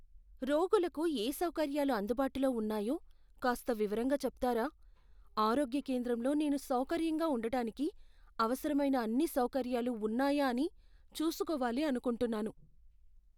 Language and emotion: Telugu, fearful